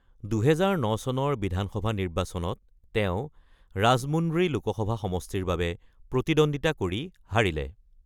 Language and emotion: Assamese, neutral